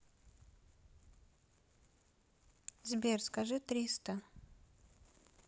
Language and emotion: Russian, neutral